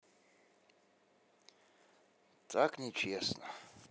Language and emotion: Russian, sad